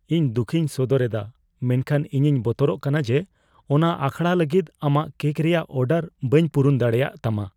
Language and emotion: Santali, fearful